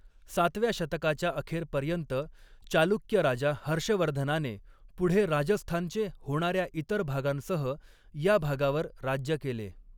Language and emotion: Marathi, neutral